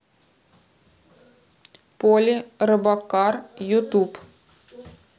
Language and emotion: Russian, neutral